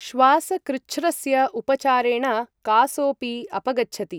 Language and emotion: Sanskrit, neutral